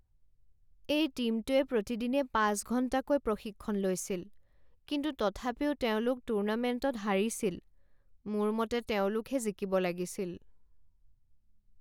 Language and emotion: Assamese, sad